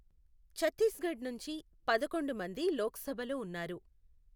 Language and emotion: Telugu, neutral